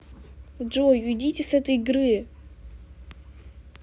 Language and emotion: Russian, angry